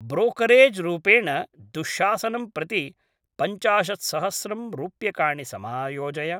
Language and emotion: Sanskrit, neutral